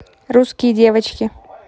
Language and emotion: Russian, neutral